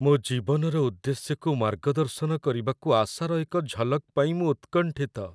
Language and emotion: Odia, sad